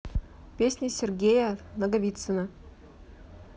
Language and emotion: Russian, neutral